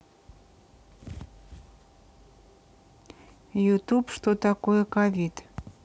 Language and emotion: Russian, neutral